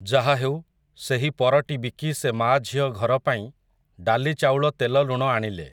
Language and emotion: Odia, neutral